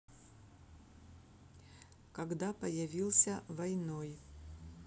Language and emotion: Russian, neutral